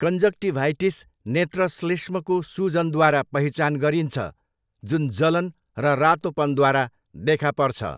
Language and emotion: Nepali, neutral